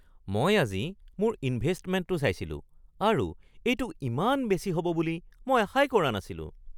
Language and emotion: Assamese, surprised